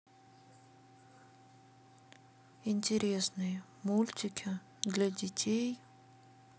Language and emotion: Russian, sad